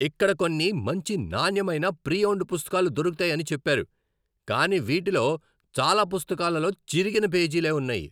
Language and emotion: Telugu, angry